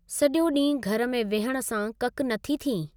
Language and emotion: Sindhi, neutral